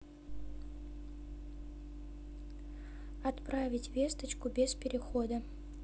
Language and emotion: Russian, neutral